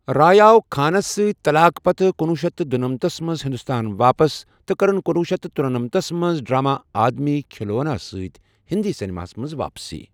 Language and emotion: Kashmiri, neutral